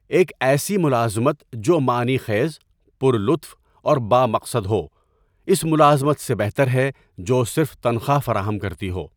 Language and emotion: Urdu, neutral